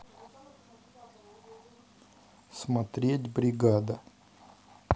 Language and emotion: Russian, neutral